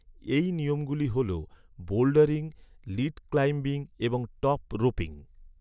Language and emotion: Bengali, neutral